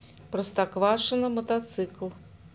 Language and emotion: Russian, neutral